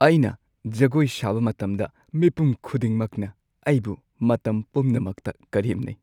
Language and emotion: Manipuri, sad